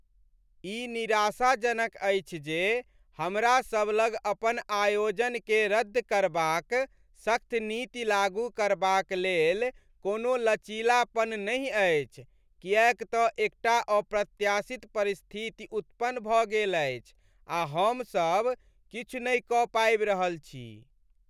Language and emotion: Maithili, sad